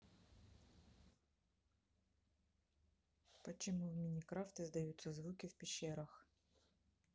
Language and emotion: Russian, neutral